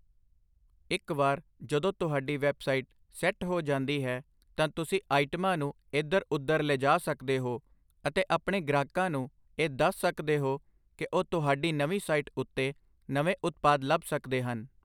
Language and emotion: Punjabi, neutral